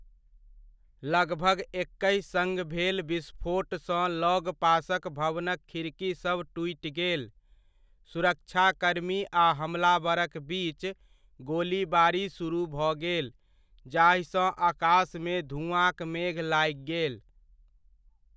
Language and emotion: Maithili, neutral